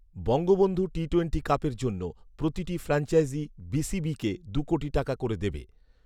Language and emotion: Bengali, neutral